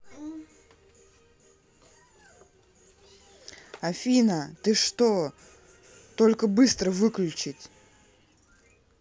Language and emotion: Russian, angry